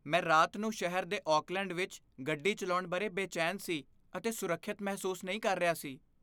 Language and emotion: Punjabi, fearful